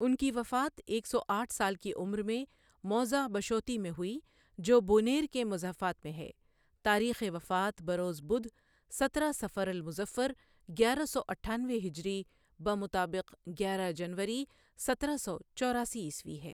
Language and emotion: Urdu, neutral